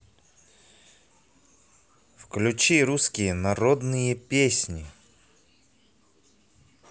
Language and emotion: Russian, positive